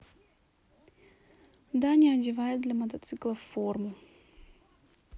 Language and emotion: Russian, neutral